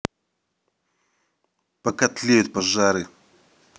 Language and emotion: Russian, angry